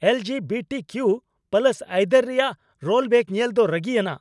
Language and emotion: Santali, angry